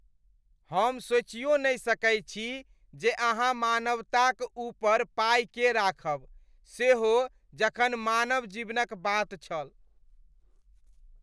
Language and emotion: Maithili, disgusted